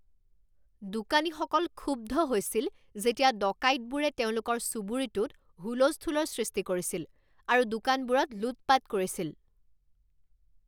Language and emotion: Assamese, angry